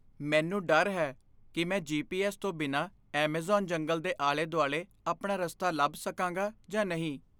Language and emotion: Punjabi, fearful